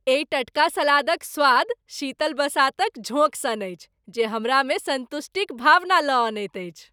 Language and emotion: Maithili, happy